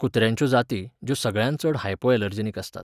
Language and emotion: Goan Konkani, neutral